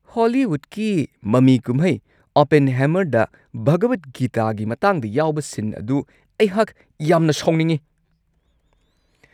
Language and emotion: Manipuri, angry